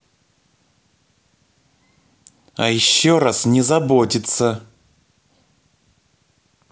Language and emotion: Russian, angry